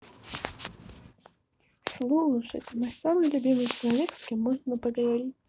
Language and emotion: Russian, positive